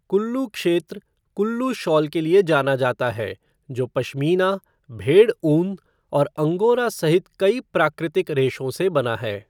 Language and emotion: Hindi, neutral